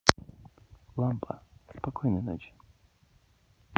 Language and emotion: Russian, neutral